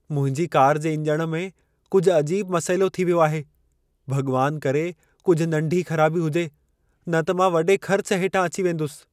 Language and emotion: Sindhi, fearful